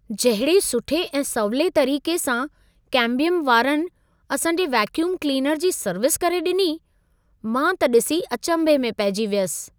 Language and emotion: Sindhi, surprised